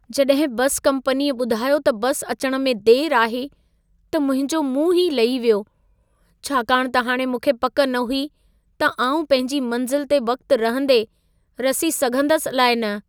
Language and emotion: Sindhi, sad